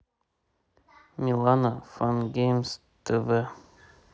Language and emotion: Russian, neutral